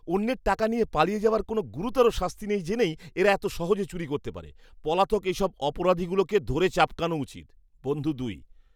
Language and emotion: Bengali, disgusted